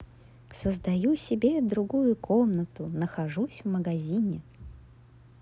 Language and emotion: Russian, positive